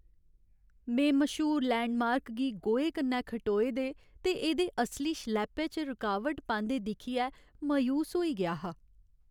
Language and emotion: Dogri, sad